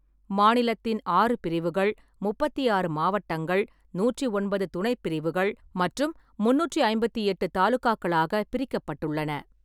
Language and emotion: Tamil, neutral